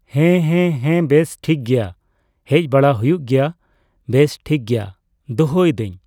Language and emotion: Santali, neutral